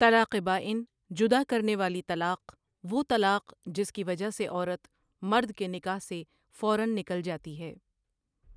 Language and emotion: Urdu, neutral